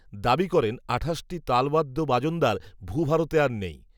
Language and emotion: Bengali, neutral